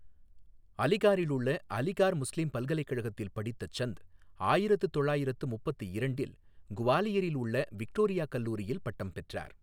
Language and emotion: Tamil, neutral